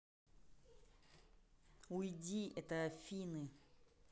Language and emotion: Russian, angry